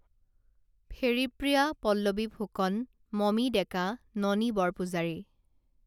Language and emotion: Assamese, neutral